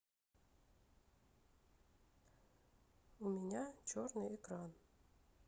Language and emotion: Russian, sad